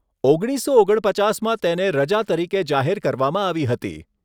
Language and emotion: Gujarati, neutral